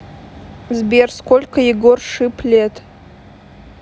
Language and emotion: Russian, neutral